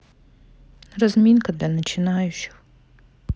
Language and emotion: Russian, sad